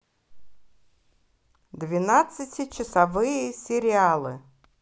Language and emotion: Russian, positive